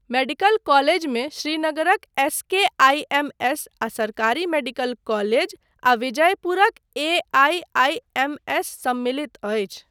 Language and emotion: Maithili, neutral